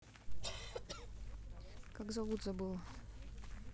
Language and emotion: Russian, neutral